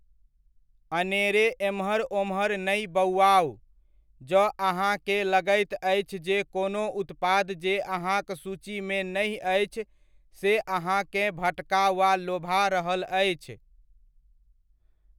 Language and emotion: Maithili, neutral